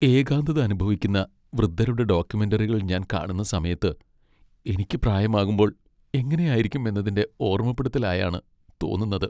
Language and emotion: Malayalam, sad